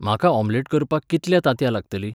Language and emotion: Goan Konkani, neutral